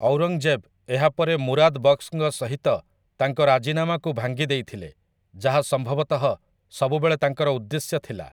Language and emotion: Odia, neutral